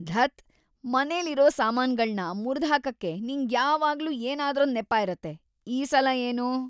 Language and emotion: Kannada, disgusted